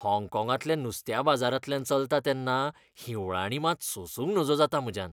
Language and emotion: Goan Konkani, disgusted